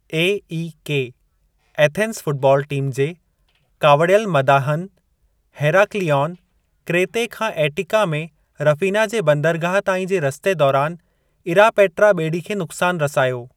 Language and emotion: Sindhi, neutral